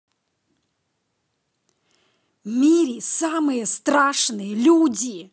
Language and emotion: Russian, angry